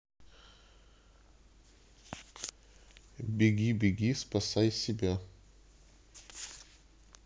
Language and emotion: Russian, neutral